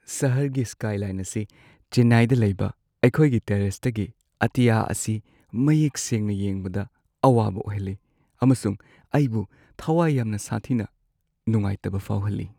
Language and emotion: Manipuri, sad